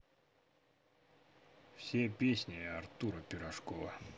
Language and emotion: Russian, neutral